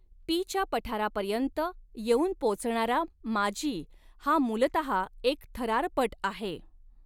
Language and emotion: Marathi, neutral